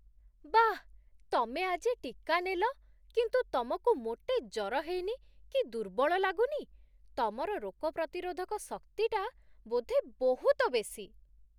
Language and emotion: Odia, surprised